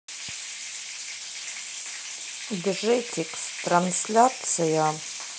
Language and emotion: Russian, neutral